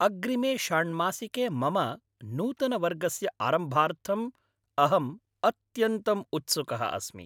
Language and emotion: Sanskrit, happy